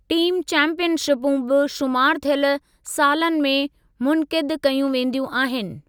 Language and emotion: Sindhi, neutral